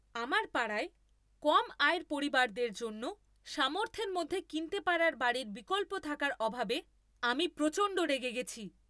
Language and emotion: Bengali, angry